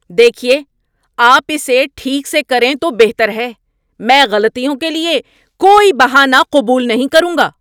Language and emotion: Urdu, angry